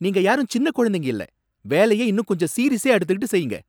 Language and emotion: Tamil, angry